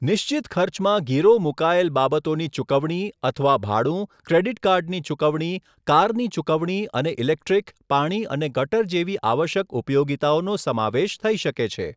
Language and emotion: Gujarati, neutral